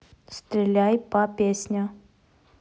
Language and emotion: Russian, neutral